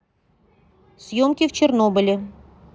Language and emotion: Russian, neutral